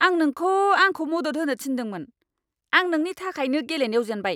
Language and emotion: Bodo, angry